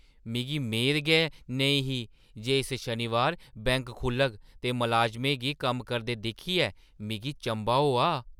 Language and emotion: Dogri, surprised